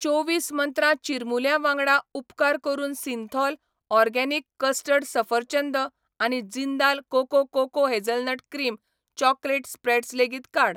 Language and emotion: Goan Konkani, neutral